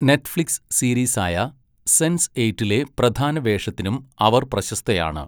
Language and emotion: Malayalam, neutral